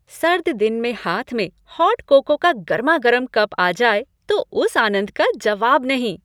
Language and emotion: Hindi, happy